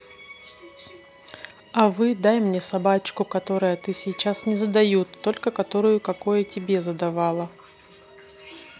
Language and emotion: Russian, neutral